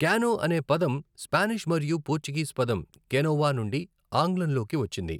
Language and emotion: Telugu, neutral